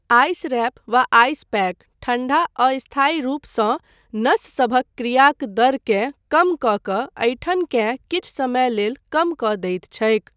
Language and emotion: Maithili, neutral